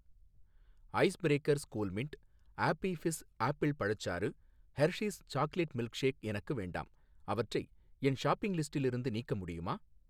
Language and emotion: Tamil, neutral